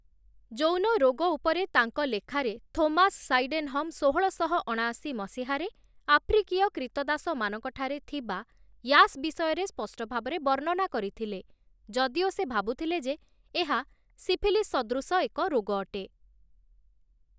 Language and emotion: Odia, neutral